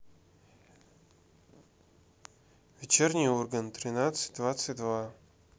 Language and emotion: Russian, neutral